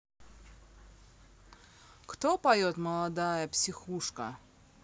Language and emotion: Russian, neutral